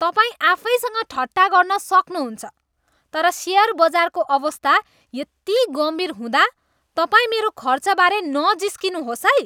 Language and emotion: Nepali, disgusted